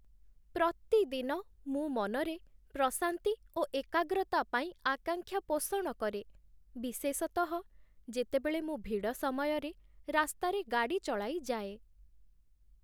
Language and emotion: Odia, sad